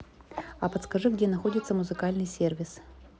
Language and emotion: Russian, neutral